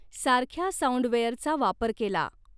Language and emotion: Marathi, neutral